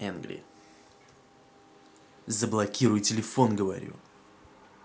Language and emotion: Russian, angry